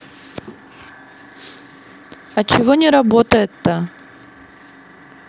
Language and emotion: Russian, angry